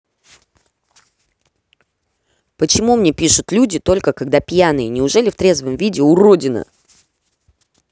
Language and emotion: Russian, angry